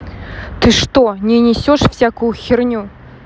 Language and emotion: Russian, angry